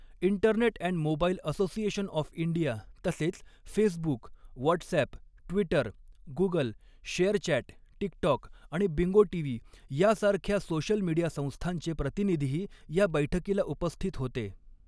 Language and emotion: Marathi, neutral